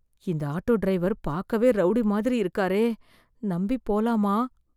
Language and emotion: Tamil, fearful